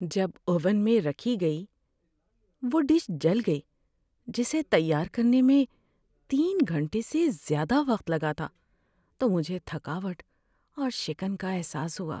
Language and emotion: Urdu, sad